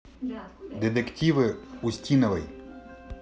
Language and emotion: Russian, neutral